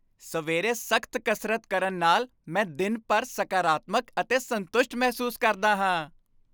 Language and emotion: Punjabi, happy